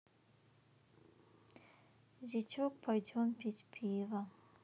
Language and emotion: Russian, sad